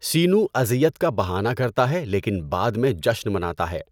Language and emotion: Urdu, neutral